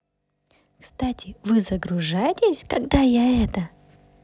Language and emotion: Russian, positive